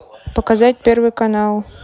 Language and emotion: Russian, neutral